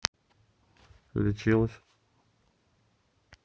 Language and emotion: Russian, neutral